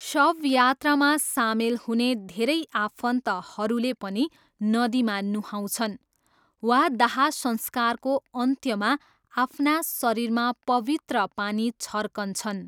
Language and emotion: Nepali, neutral